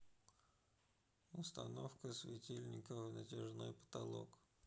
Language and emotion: Russian, neutral